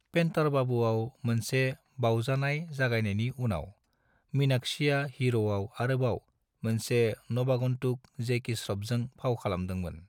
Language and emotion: Bodo, neutral